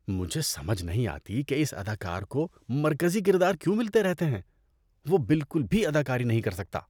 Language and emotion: Urdu, disgusted